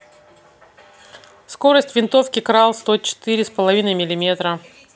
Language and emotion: Russian, neutral